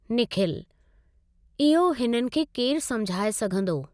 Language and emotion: Sindhi, neutral